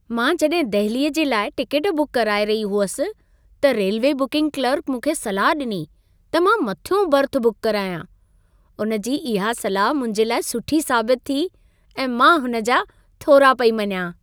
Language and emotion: Sindhi, happy